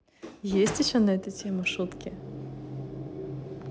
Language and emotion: Russian, positive